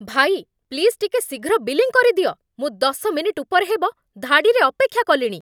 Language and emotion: Odia, angry